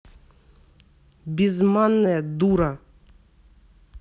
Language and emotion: Russian, angry